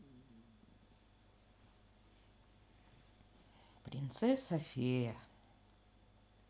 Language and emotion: Russian, sad